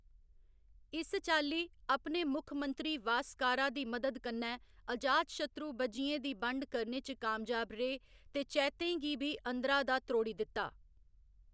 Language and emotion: Dogri, neutral